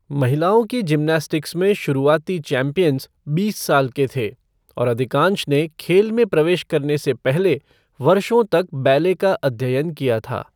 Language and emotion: Hindi, neutral